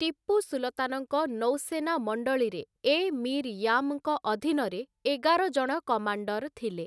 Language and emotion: Odia, neutral